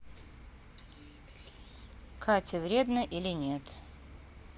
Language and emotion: Russian, neutral